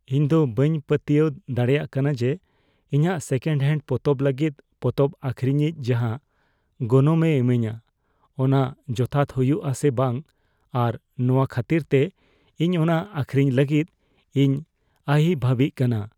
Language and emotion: Santali, fearful